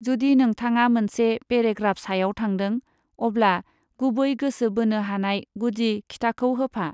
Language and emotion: Bodo, neutral